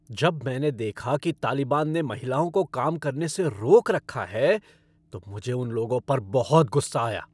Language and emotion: Hindi, angry